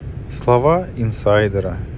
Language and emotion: Russian, neutral